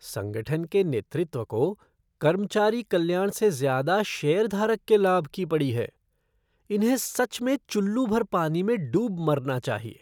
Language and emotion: Hindi, disgusted